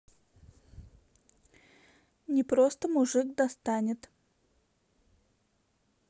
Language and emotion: Russian, neutral